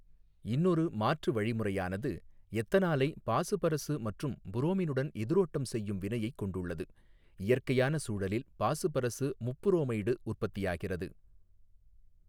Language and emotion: Tamil, neutral